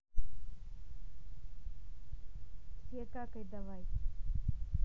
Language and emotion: Russian, neutral